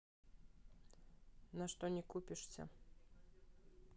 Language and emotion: Russian, neutral